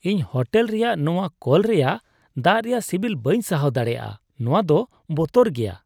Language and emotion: Santali, disgusted